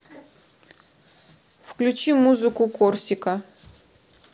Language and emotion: Russian, neutral